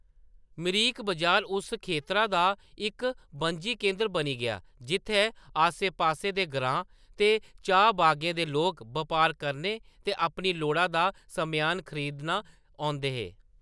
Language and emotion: Dogri, neutral